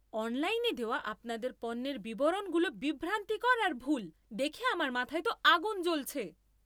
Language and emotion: Bengali, angry